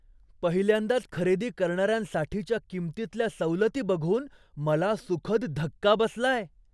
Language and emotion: Marathi, surprised